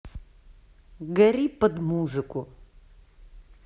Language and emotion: Russian, neutral